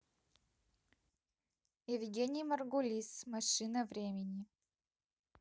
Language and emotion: Russian, neutral